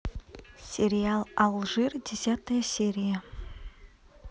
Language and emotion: Russian, neutral